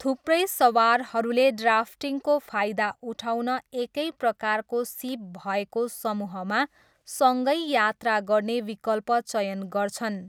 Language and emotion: Nepali, neutral